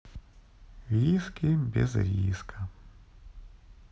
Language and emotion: Russian, sad